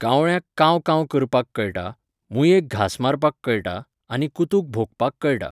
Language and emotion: Goan Konkani, neutral